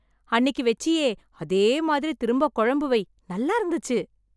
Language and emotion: Tamil, happy